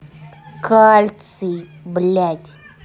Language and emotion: Russian, angry